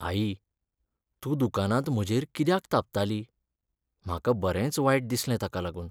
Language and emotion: Goan Konkani, sad